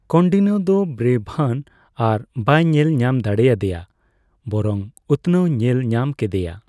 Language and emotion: Santali, neutral